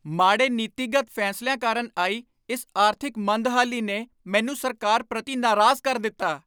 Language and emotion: Punjabi, angry